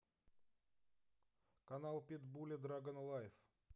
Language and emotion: Russian, neutral